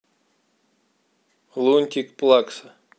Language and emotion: Russian, neutral